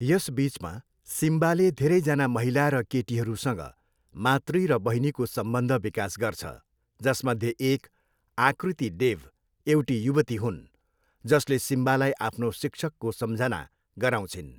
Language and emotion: Nepali, neutral